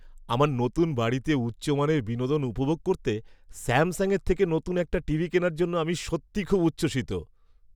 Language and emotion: Bengali, happy